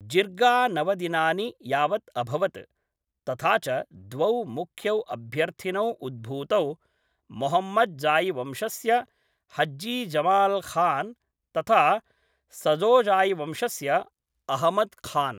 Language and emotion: Sanskrit, neutral